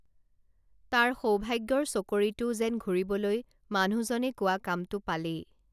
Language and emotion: Assamese, neutral